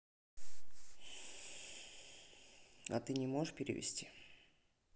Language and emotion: Russian, neutral